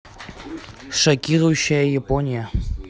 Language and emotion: Russian, neutral